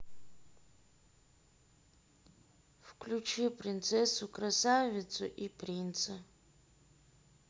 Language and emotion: Russian, neutral